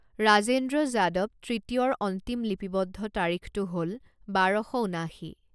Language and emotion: Assamese, neutral